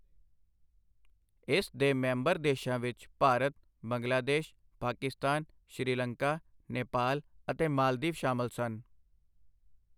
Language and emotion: Punjabi, neutral